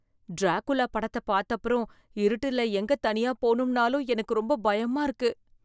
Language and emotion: Tamil, fearful